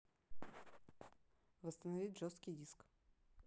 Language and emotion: Russian, neutral